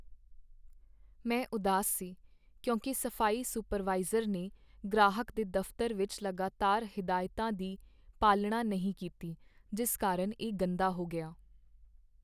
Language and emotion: Punjabi, sad